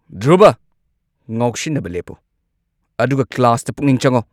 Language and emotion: Manipuri, angry